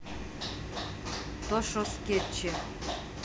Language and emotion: Russian, neutral